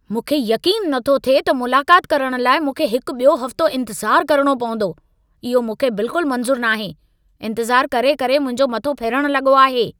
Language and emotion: Sindhi, angry